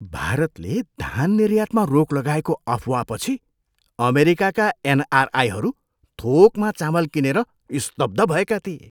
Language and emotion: Nepali, surprised